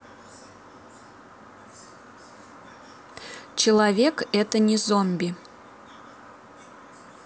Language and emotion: Russian, neutral